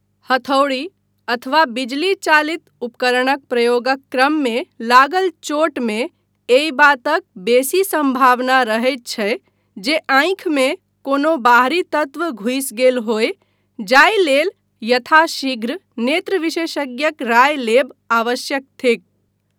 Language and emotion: Maithili, neutral